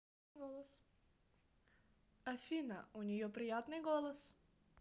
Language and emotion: Russian, positive